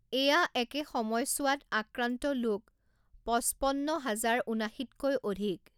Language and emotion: Assamese, neutral